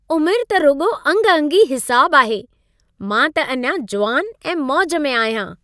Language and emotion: Sindhi, happy